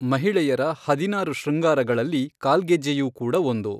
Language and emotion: Kannada, neutral